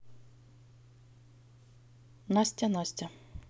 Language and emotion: Russian, neutral